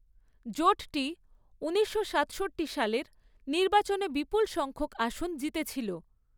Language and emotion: Bengali, neutral